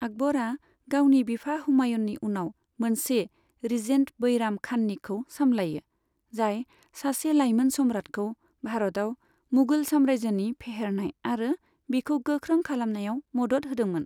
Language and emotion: Bodo, neutral